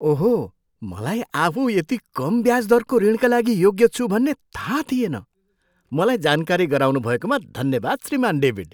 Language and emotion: Nepali, surprised